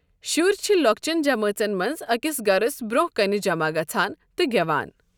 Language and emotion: Kashmiri, neutral